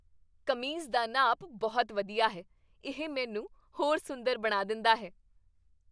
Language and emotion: Punjabi, happy